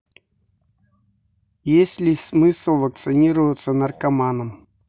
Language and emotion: Russian, neutral